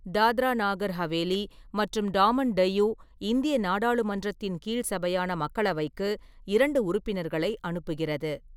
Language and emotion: Tamil, neutral